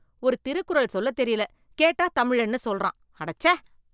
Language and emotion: Tamil, disgusted